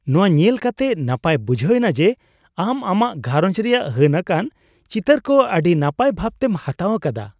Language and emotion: Santali, happy